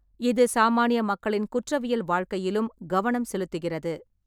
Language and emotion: Tamil, neutral